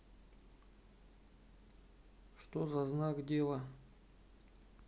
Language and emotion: Russian, neutral